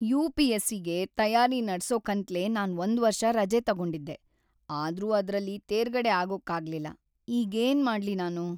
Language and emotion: Kannada, sad